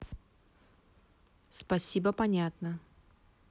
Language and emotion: Russian, neutral